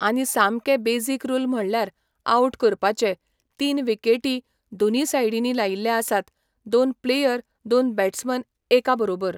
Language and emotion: Goan Konkani, neutral